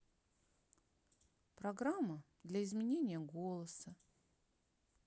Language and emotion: Russian, neutral